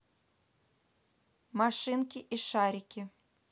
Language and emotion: Russian, neutral